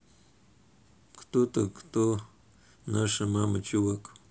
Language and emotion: Russian, neutral